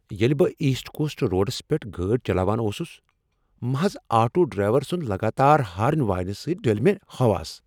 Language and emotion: Kashmiri, angry